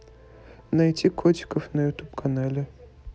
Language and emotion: Russian, neutral